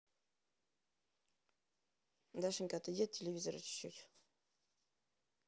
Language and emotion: Russian, neutral